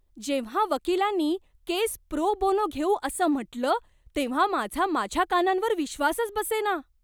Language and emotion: Marathi, surprised